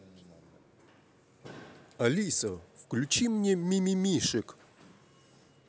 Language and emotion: Russian, positive